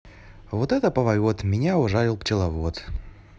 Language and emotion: Russian, positive